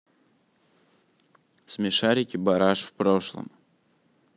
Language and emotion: Russian, neutral